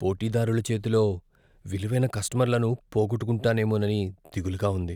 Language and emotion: Telugu, fearful